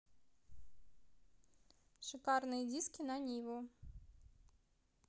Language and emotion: Russian, neutral